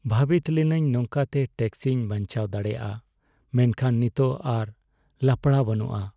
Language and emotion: Santali, sad